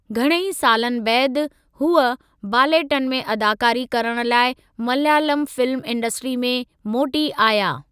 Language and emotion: Sindhi, neutral